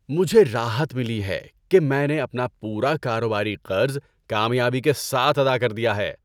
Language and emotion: Urdu, happy